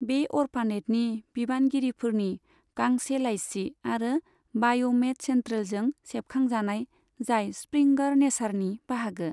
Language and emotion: Bodo, neutral